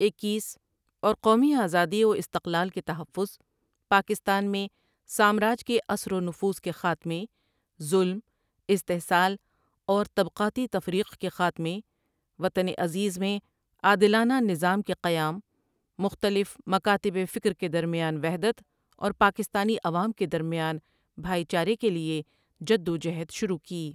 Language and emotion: Urdu, neutral